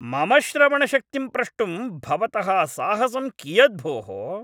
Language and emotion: Sanskrit, angry